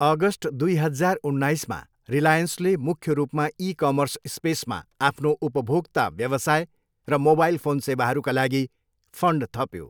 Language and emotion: Nepali, neutral